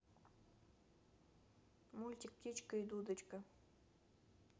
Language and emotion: Russian, neutral